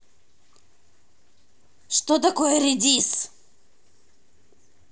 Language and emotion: Russian, angry